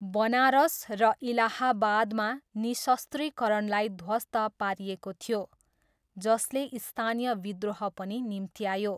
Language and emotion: Nepali, neutral